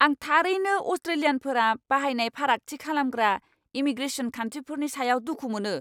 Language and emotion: Bodo, angry